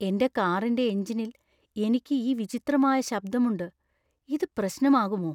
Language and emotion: Malayalam, fearful